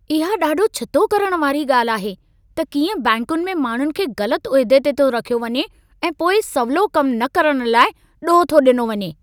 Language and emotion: Sindhi, angry